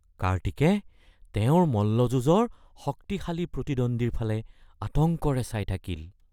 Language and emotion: Assamese, fearful